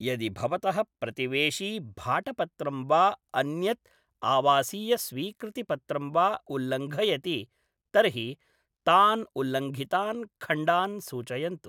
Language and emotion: Sanskrit, neutral